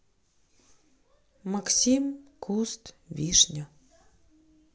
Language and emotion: Russian, neutral